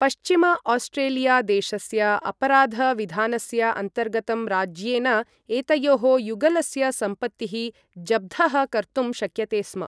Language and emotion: Sanskrit, neutral